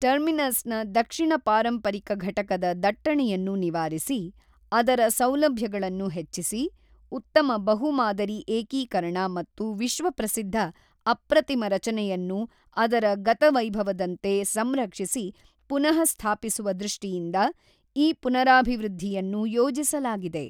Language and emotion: Kannada, neutral